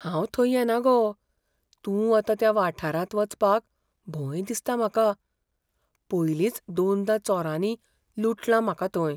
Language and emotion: Goan Konkani, fearful